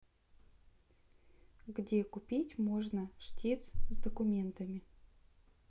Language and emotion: Russian, neutral